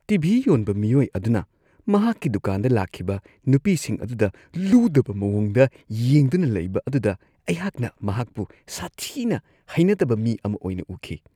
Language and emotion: Manipuri, disgusted